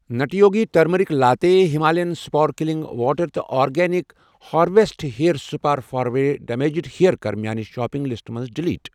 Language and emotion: Kashmiri, neutral